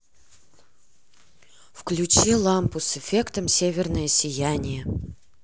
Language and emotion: Russian, positive